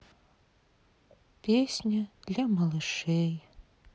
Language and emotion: Russian, sad